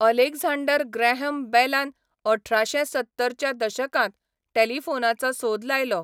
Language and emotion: Goan Konkani, neutral